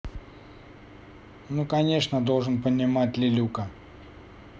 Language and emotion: Russian, neutral